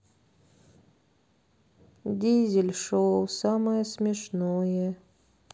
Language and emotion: Russian, sad